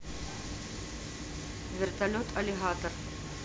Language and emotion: Russian, neutral